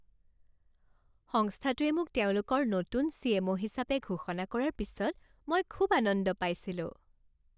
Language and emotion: Assamese, happy